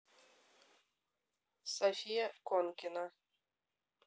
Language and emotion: Russian, neutral